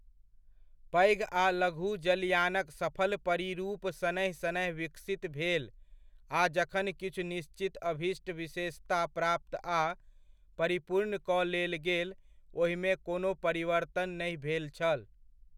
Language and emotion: Maithili, neutral